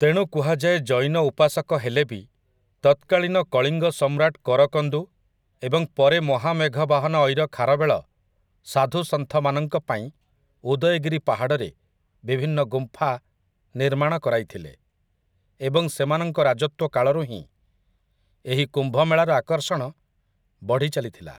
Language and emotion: Odia, neutral